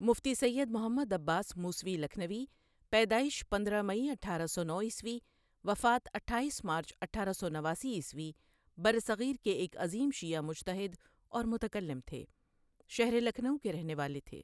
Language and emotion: Urdu, neutral